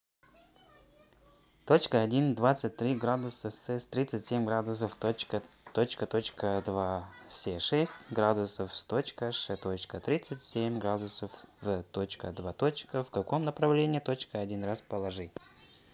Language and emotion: Russian, neutral